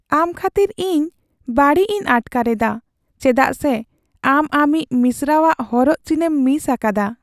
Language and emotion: Santali, sad